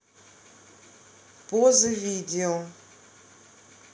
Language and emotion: Russian, neutral